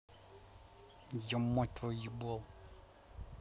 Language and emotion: Russian, angry